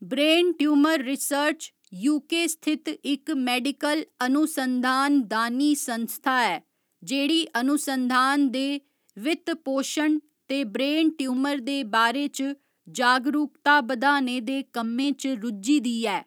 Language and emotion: Dogri, neutral